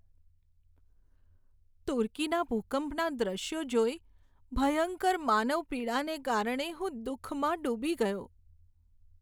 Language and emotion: Gujarati, sad